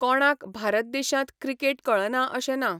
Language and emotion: Goan Konkani, neutral